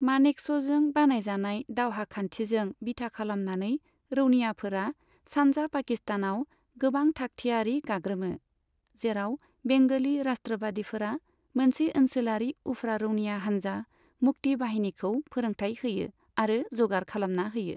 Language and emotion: Bodo, neutral